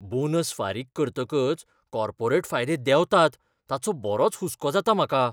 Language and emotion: Goan Konkani, fearful